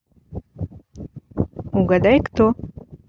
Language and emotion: Russian, neutral